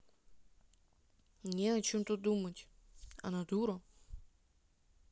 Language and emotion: Russian, neutral